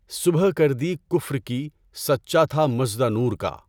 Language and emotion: Urdu, neutral